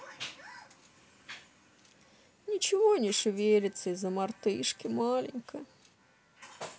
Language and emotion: Russian, sad